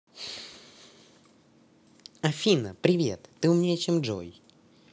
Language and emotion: Russian, positive